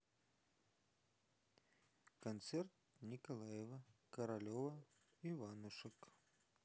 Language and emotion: Russian, neutral